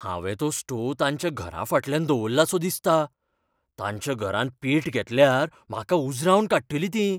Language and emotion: Goan Konkani, fearful